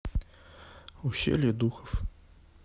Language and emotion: Russian, sad